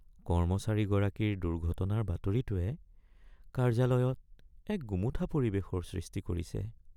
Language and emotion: Assamese, sad